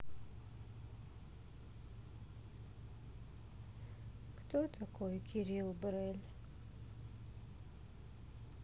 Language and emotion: Russian, sad